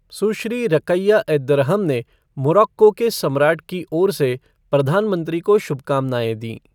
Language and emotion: Hindi, neutral